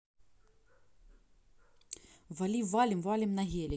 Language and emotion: Russian, neutral